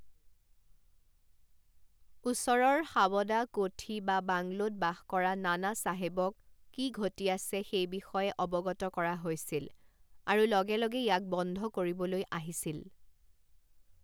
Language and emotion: Assamese, neutral